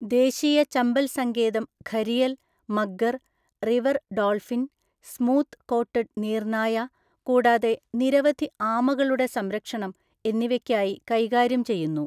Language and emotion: Malayalam, neutral